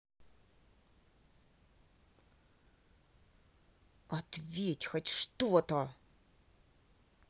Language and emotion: Russian, angry